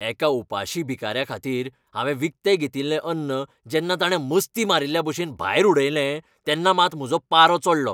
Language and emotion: Goan Konkani, angry